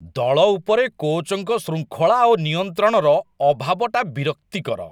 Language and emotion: Odia, disgusted